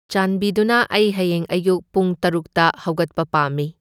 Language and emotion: Manipuri, neutral